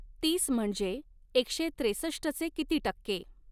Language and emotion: Marathi, neutral